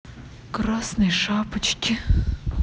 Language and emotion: Russian, sad